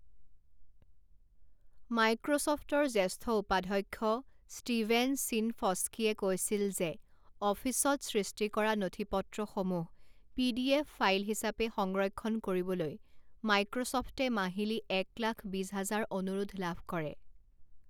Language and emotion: Assamese, neutral